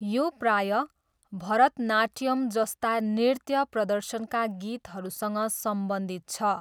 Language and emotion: Nepali, neutral